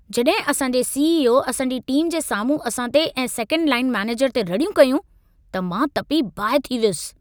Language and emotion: Sindhi, angry